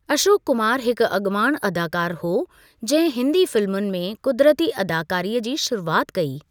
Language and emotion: Sindhi, neutral